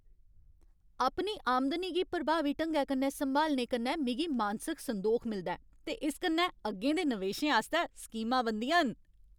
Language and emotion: Dogri, happy